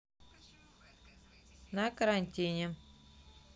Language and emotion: Russian, neutral